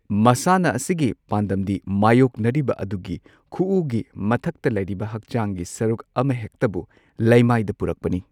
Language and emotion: Manipuri, neutral